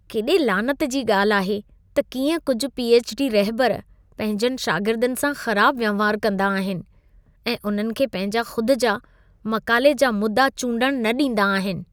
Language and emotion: Sindhi, disgusted